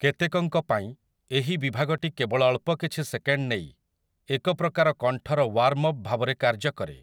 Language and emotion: Odia, neutral